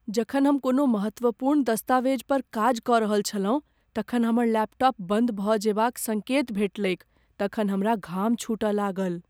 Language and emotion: Maithili, fearful